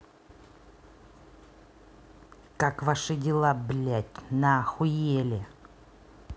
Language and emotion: Russian, angry